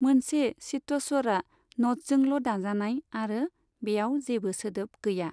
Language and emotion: Bodo, neutral